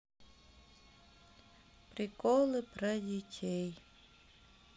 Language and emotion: Russian, sad